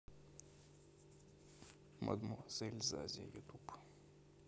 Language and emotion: Russian, neutral